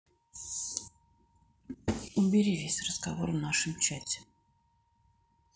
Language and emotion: Russian, sad